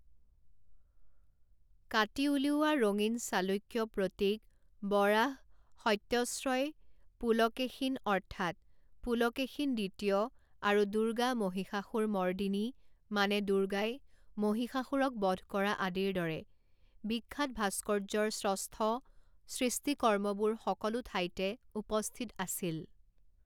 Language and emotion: Assamese, neutral